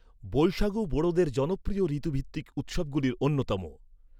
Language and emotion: Bengali, neutral